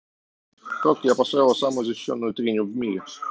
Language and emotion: Russian, neutral